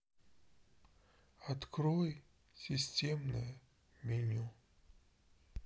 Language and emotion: Russian, sad